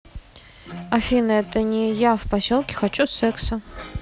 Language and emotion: Russian, neutral